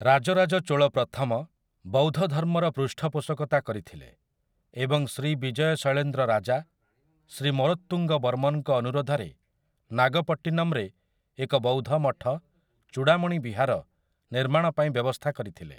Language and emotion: Odia, neutral